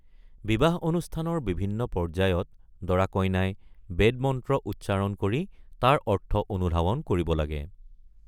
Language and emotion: Assamese, neutral